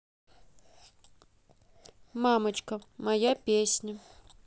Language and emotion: Russian, neutral